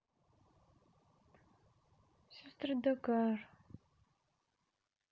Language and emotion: Russian, neutral